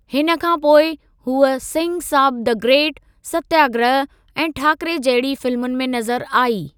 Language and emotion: Sindhi, neutral